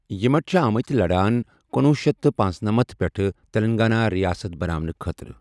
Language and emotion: Kashmiri, neutral